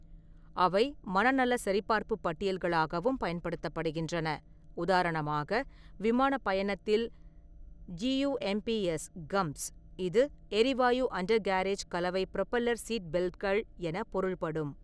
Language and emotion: Tamil, neutral